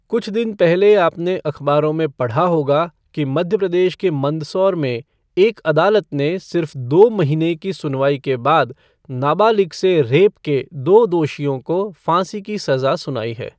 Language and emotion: Hindi, neutral